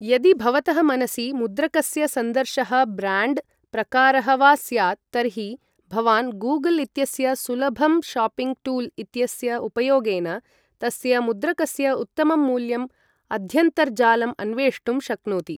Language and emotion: Sanskrit, neutral